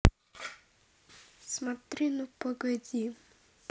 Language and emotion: Russian, neutral